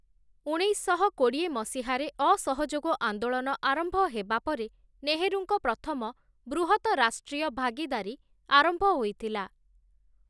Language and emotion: Odia, neutral